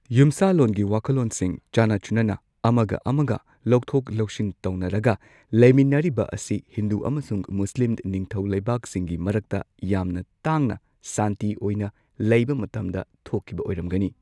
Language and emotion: Manipuri, neutral